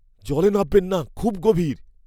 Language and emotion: Bengali, fearful